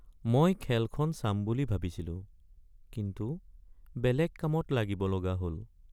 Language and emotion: Assamese, sad